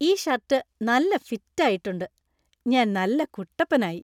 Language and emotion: Malayalam, happy